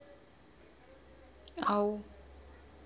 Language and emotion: Russian, neutral